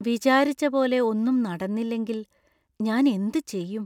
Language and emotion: Malayalam, fearful